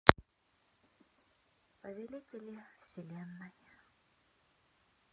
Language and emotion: Russian, neutral